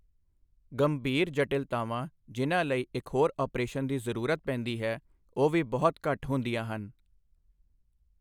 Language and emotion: Punjabi, neutral